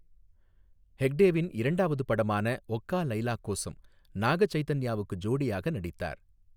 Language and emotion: Tamil, neutral